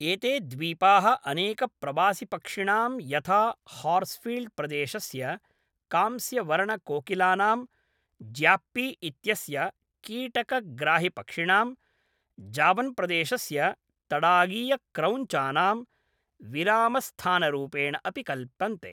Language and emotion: Sanskrit, neutral